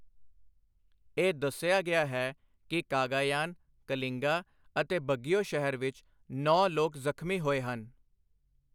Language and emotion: Punjabi, neutral